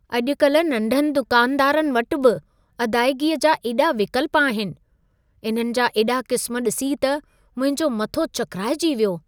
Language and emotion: Sindhi, surprised